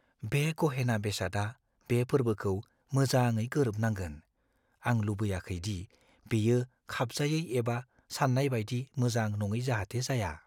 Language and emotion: Bodo, fearful